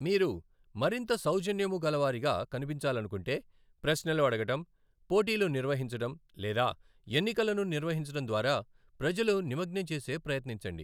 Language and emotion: Telugu, neutral